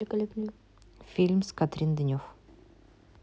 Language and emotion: Russian, neutral